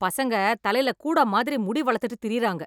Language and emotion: Tamil, angry